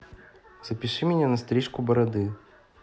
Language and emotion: Russian, neutral